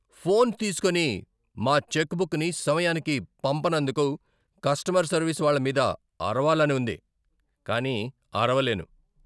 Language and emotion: Telugu, angry